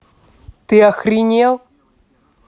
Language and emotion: Russian, angry